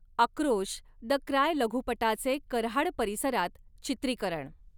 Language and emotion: Marathi, neutral